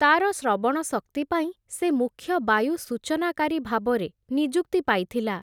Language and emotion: Odia, neutral